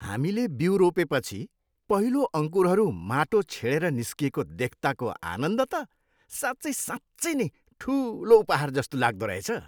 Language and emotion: Nepali, happy